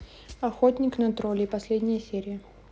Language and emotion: Russian, neutral